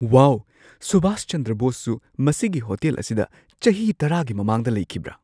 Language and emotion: Manipuri, surprised